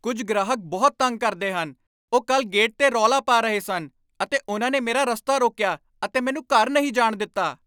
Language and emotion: Punjabi, angry